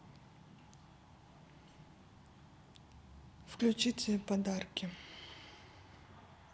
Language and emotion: Russian, neutral